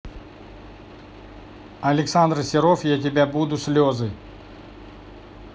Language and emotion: Russian, neutral